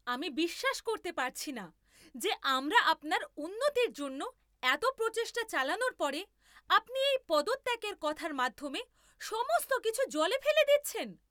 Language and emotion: Bengali, angry